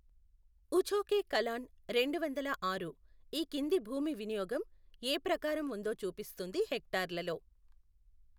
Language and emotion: Telugu, neutral